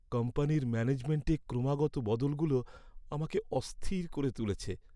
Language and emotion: Bengali, sad